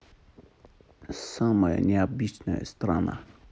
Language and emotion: Russian, neutral